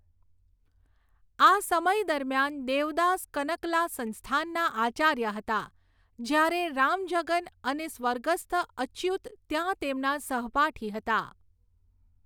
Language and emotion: Gujarati, neutral